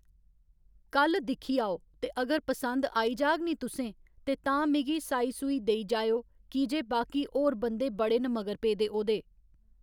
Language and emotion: Dogri, neutral